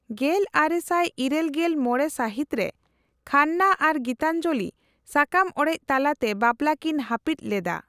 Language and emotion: Santali, neutral